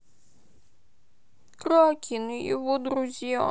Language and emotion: Russian, sad